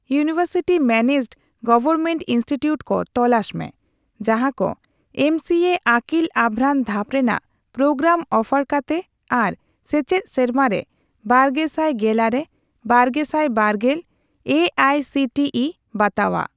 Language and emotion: Santali, neutral